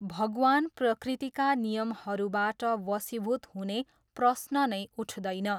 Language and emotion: Nepali, neutral